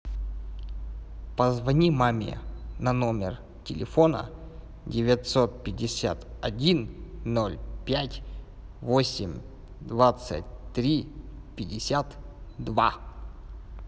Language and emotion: Russian, neutral